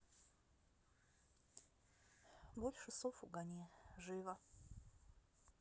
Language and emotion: Russian, neutral